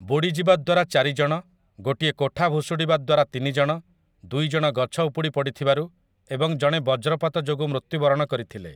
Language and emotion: Odia, neutral